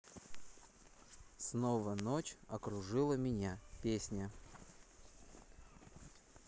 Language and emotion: Russian, neutral